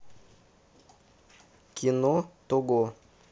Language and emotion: Russian, neutral